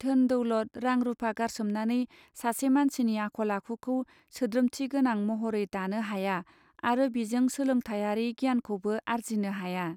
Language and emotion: Bodo, neutral